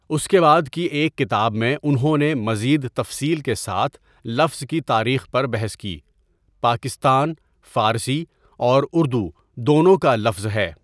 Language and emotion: Urdu, neutral